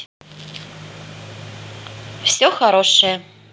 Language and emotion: Russian, positive